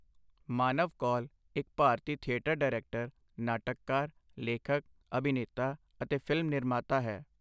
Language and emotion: Punjabi, neutral